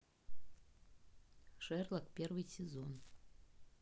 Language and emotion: Russian, neutral